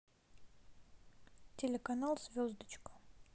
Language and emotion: Russian, neutral